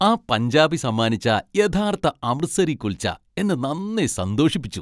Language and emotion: Malayalam, happy